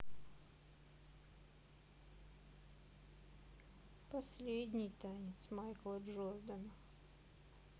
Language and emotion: Russian, sad